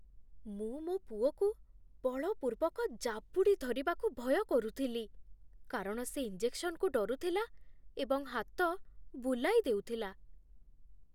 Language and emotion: Odia, fearful